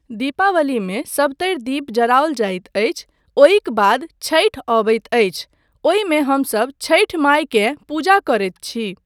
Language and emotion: Maithili, neutral